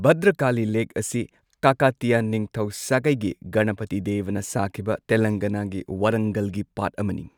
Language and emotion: Manipuri, neutral